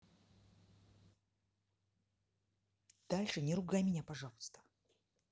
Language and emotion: Russian, angry